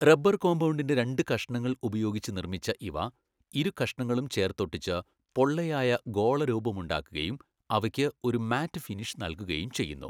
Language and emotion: Malayalam, neutral